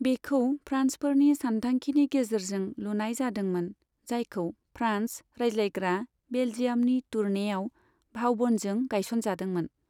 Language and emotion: Bodo, neutral